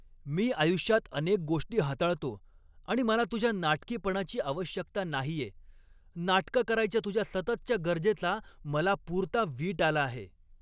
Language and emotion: Marathi, angry